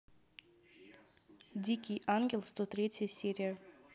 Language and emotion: Russian, neutral